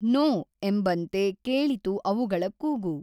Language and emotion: Kannada, neutral